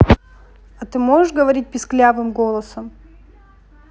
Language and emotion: Russian, neutral